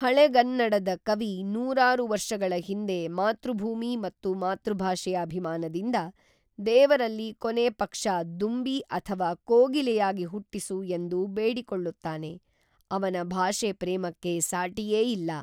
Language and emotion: Kannada, neutral